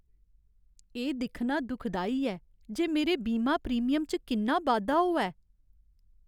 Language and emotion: Dogri, sad